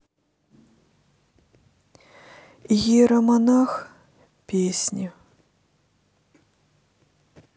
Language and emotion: Russian, sad